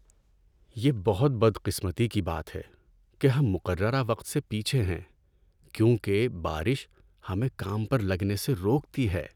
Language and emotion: Urdu, sad